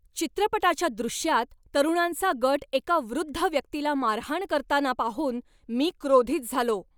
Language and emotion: Marathi, angry